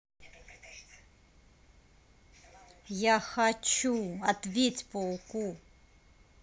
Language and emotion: Russian, angry